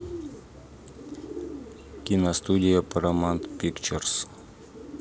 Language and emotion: Russian, neutral